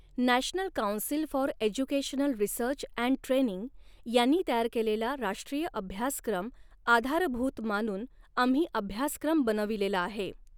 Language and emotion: Marathi, neutral